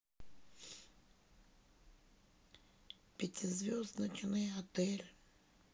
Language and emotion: Russian, sad